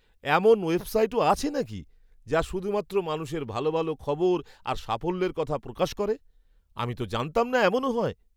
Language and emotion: Bengali, surprised